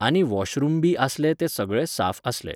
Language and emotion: Goan Konkani, neutral